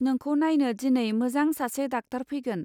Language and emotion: Bodo, neutral